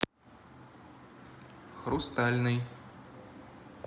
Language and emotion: Russian, neutral